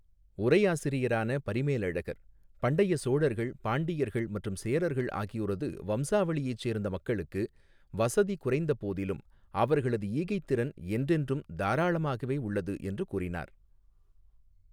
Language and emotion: Tamil, neutral